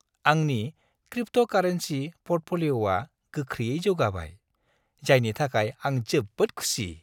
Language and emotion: Bodo, happy